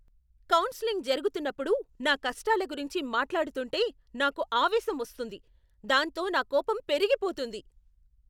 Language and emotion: Telugu, angry